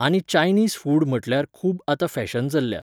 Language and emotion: Goan Konkani, neutral